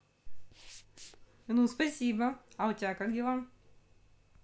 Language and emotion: Russian, positive